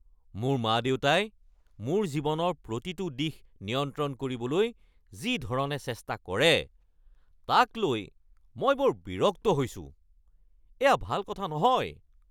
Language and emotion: Assamese, angry